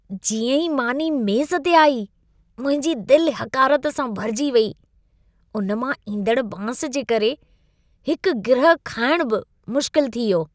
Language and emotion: Sindhi, disgusted